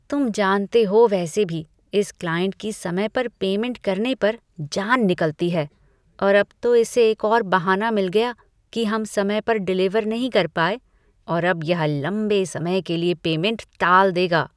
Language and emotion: Hindi, disgusted